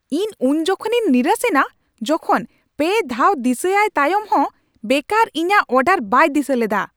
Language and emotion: Santali, angry